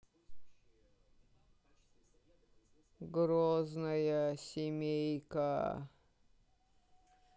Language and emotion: Russian, sad